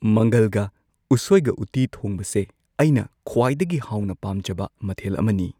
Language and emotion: Manipuri, neutral